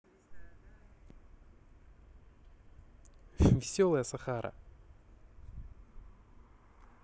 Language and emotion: Russian, positive